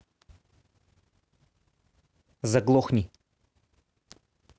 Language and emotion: Russian, angry